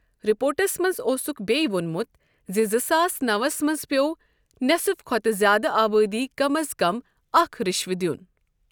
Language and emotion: Kashmiri, neutral